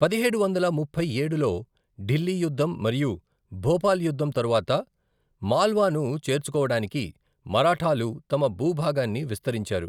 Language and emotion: Telugu, neutral